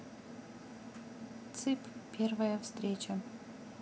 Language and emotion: Russian, neutral